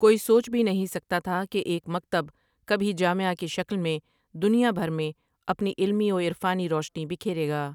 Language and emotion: Urdu, neutral